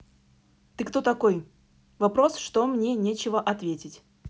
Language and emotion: Russian, neutral